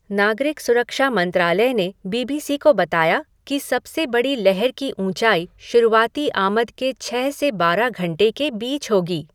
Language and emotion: Hindi, neutral